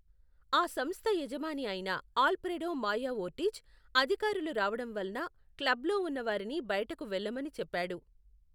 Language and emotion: Telugu, neutral